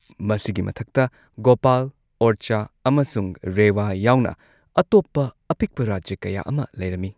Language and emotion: Manipuri, neutral